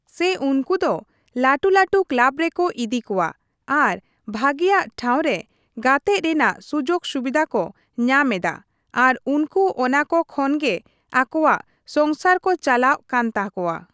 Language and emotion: Santali, neutral